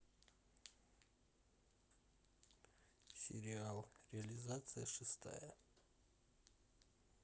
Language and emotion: Russian, neutral